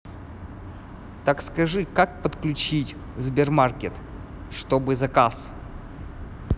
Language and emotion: Russian, neutral